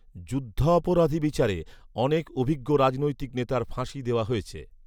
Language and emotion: Bengali, neutral